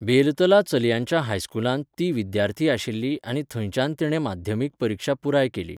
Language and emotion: Goan Konkani, neutral